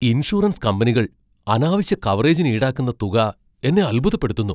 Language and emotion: Malayalam, surprised